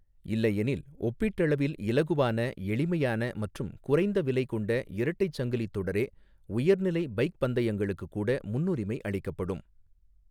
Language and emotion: Tamil, neutral